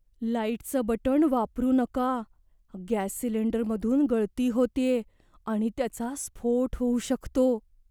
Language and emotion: Marathi, fearful